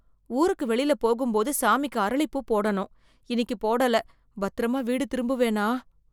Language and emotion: Tamil, fearful